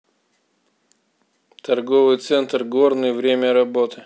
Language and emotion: Russian, neutral